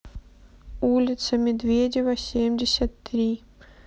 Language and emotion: Russian, sad